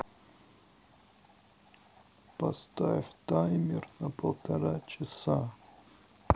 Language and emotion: Russian, sad